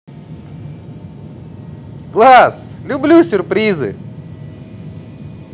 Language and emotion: Russian, positive